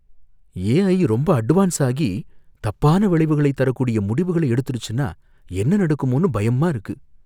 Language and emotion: Tamil, fearful